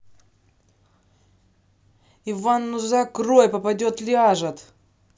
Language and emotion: Russian, angry